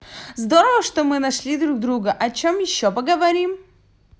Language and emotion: Russian, positive